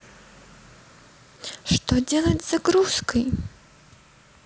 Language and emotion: Russian, neutral